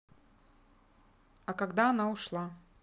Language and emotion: Russian, neutral